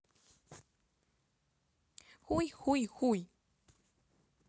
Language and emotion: Russian, neutral